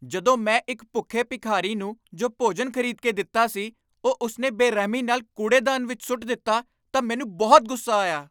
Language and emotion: Punjabi, angry